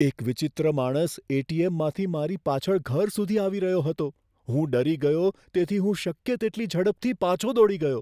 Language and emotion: Gujarati, fearful